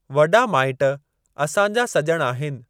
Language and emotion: Sindhi, neutral